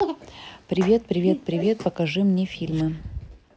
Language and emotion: Russian, neutral